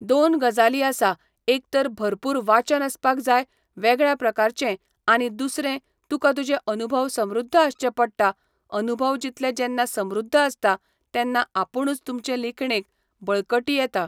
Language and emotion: Goan Konkani, neutral